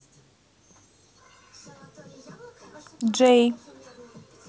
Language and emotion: Russian, neutral